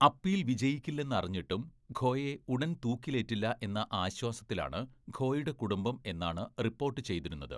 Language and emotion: Malayalam, neutral